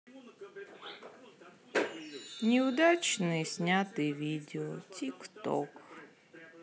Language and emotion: Russian, sad